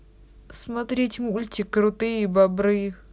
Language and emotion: Russian, neutral